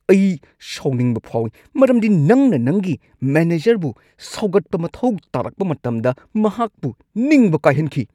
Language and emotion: Manipuri, angry